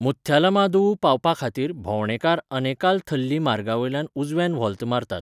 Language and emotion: Goan Konkani, neutral